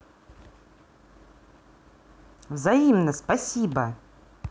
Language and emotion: Russian, angry